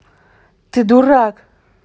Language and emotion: Russian, angry